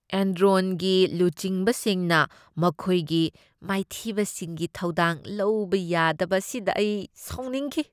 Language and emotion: Manipuri, disgusted